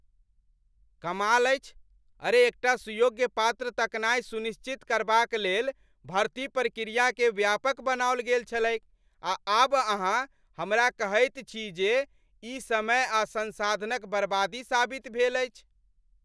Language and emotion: Maithili, angry